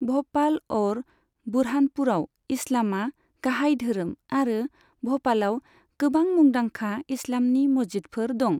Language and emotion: Bodo, neutral